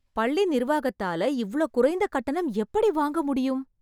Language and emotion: Tamil, surprised